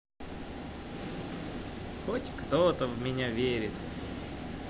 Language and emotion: Russian, positive